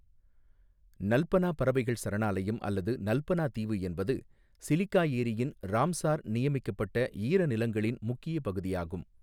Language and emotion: Tamil, neutral